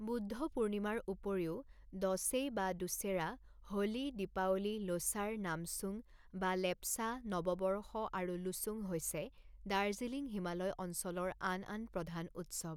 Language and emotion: Assamese, neutral